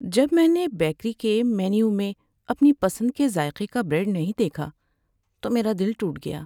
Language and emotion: Urdu, sad